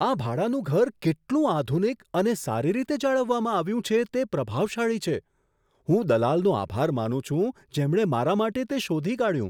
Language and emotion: Gujarati, surprised